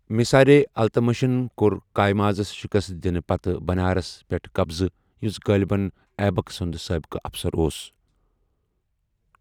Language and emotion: Kashmiri, neutral